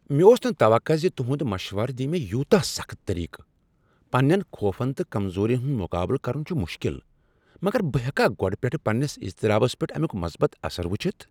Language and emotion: Kashmiri, surprised